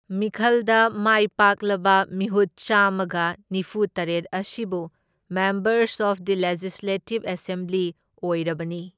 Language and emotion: Manipuri, neutral